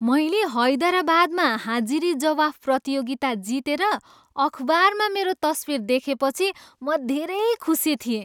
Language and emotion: Nepali, happy